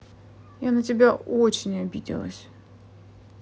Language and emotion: Russian, sad